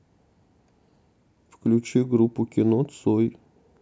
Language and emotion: Russian, neutral